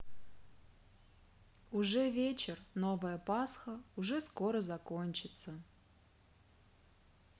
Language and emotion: Russian, sad